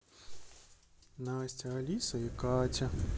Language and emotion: Russian, sad